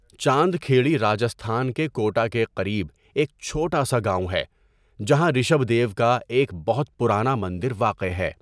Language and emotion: Urdu, neutral